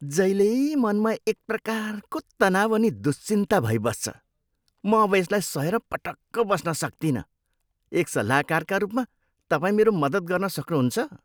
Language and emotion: Nepali, disgusted